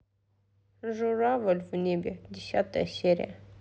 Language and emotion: Russian, neutral